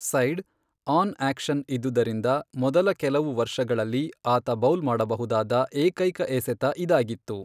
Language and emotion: Kannada, neutral